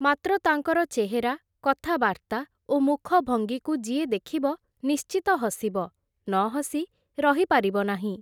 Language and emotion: Odia, neutral